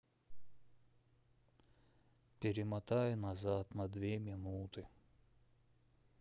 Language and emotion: Russian, sad